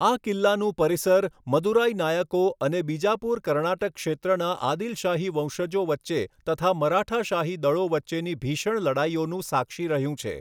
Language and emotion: Gujarati, neutral